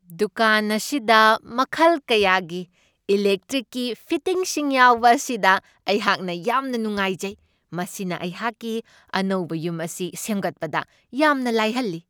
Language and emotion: Manipuri, happy